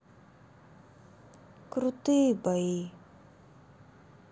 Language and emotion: Russian, sad